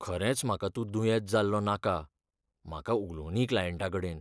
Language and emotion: Goan Konkani, fearful